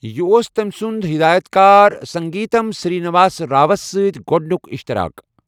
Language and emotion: Kashmiri, neutral